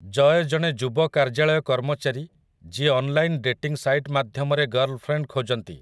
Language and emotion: Odia, neutral